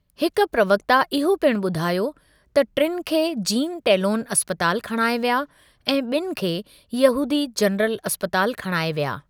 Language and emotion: Sindhi, neutral